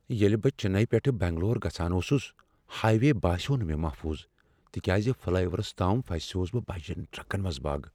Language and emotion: Kashmiri, fearful